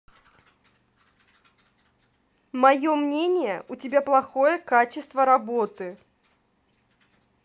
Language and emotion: Russian, angry